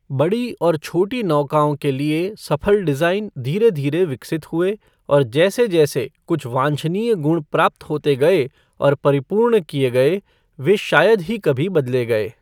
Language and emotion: Hindi, neutral